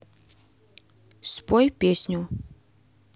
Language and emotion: Russian, neutral